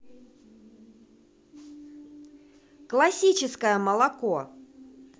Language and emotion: Russian, positive